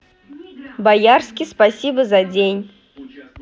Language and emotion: Russian, positive